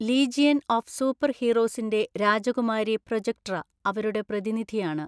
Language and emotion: Malayalam, neutral